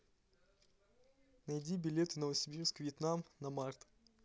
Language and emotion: Russian, neutral